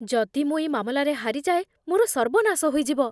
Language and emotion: Odia, fearful